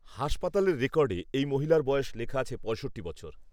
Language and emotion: Bengali, neutral